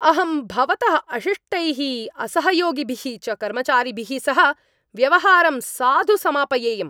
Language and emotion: Sanskrit, angry